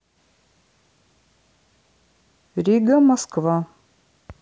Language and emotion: Russian, neutral